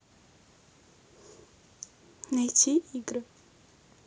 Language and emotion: Russian, neutral